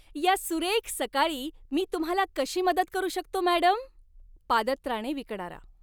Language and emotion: Marathi, happy